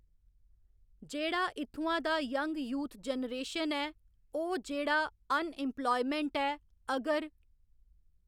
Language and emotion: Dogri, neutral